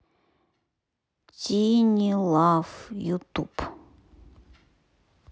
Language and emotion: Russian, neutral